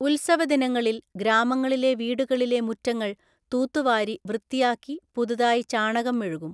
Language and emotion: Malayalam, neutral